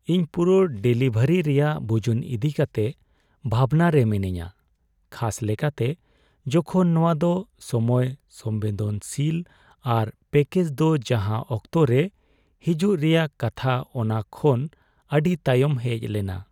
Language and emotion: Santali, sad